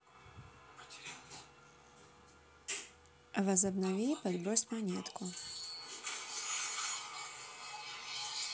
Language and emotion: Russian, neutral